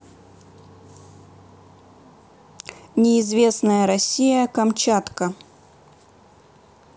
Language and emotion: Russian, neutral